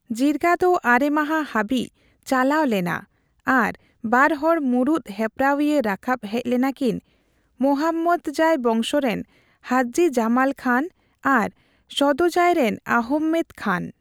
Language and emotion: Santali, neutral